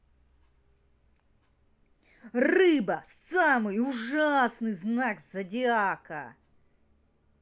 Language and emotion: Russian, angry